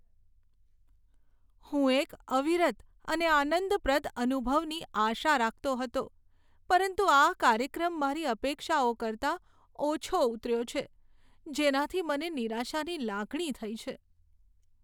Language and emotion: Gujarati, sad